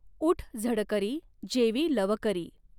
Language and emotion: Marathi, neutral